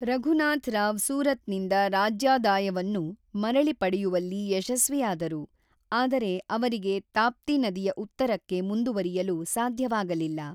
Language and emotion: Kannada, neutral